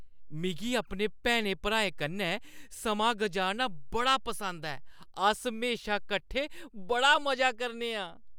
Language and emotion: Dogri, happy